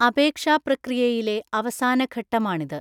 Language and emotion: Malayalam, neutral